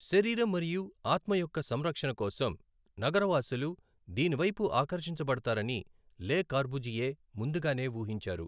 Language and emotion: Telugu, neutral